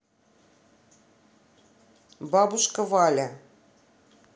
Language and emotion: Russian, neutral